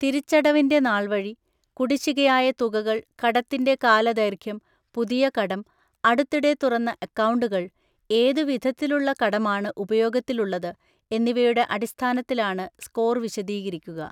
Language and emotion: Malayalam, neutral